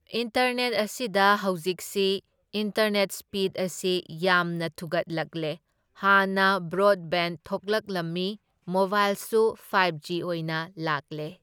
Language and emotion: Manipuri, neutral